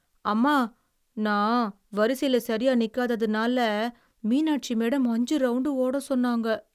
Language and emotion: Tamil, sad